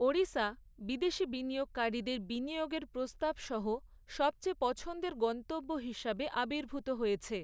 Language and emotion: Bengali, neutral